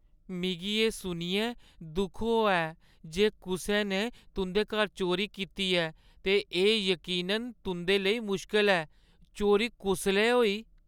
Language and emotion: Dogri, sad